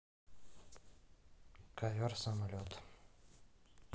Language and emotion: Russian, neutral